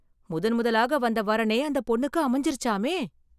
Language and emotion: Tamil, surprised